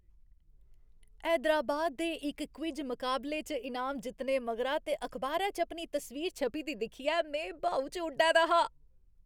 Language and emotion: Dogri, happy